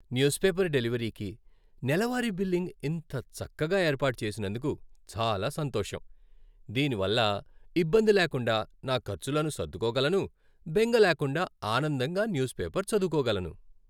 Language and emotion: Telugu, happy